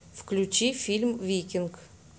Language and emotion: Russian, neutral